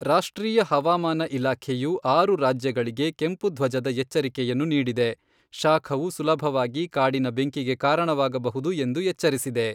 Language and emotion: Kannada, neutral